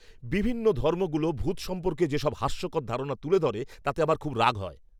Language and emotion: Bengali, angry